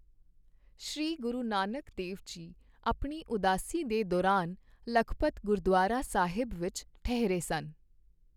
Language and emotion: Punjabi, neutral